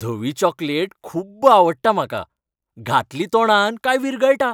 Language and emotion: Goan Konkani, happy